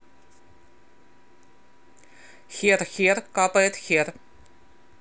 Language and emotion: Russian, neutral